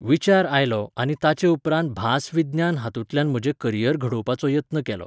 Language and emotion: Goan Konkani, neutral